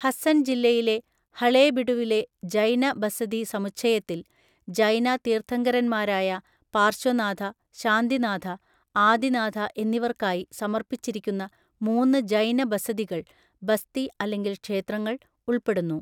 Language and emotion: Malayalam, neutral